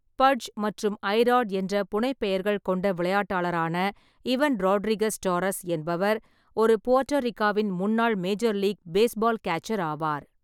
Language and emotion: Tamil, neutral